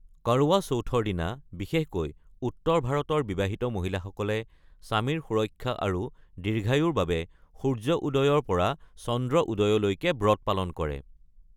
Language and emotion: Assamese, neutral